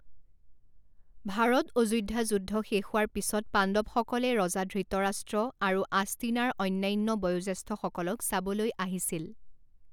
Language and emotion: Assamese, neutral